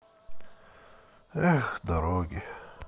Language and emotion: Russian, sad